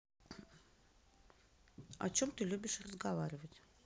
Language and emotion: Russian, neutral